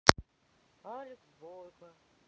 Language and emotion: Russian, sad